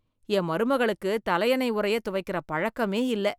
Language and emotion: Tamil, disgusted